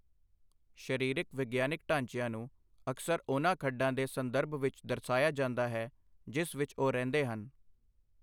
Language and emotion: Punjabi, neutral